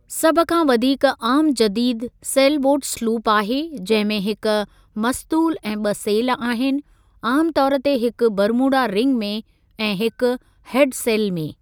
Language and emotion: Sindhi, neutral